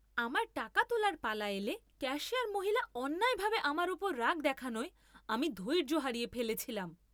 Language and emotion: Bengali, angry